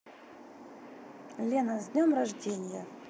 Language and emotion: Russian, neutral